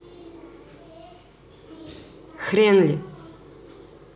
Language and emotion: Russian, neutral